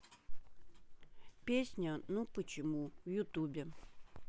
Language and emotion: Russian, neutral